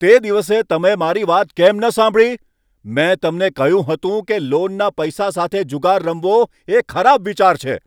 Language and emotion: Gujarati, angry